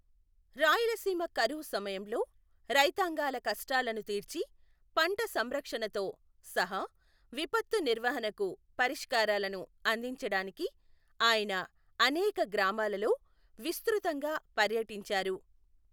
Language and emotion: Telugu, neutral